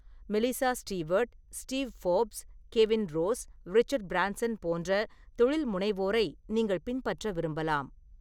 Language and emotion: Tamil, neutral